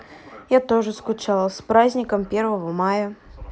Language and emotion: Russian, neutral